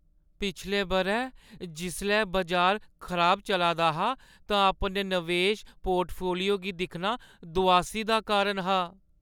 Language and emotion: Dogri, sad